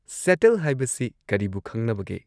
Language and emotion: Manipuri, neutral